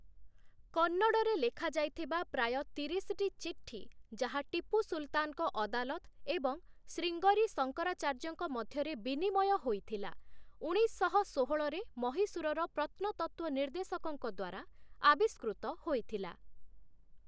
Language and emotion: Odia, neutral